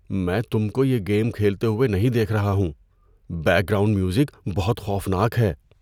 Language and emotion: Urdu, fearful